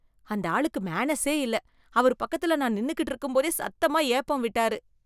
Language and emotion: Tamil, disgusted